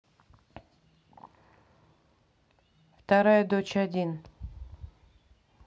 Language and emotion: Russian, neutral